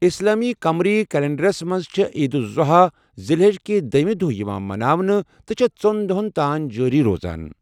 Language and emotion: Kashmiri, neutral